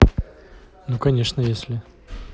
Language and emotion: Russian, neutral